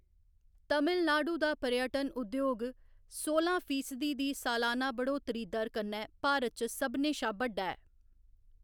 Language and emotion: Dogri, neutral